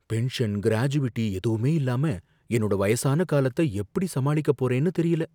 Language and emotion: Tamil, fearful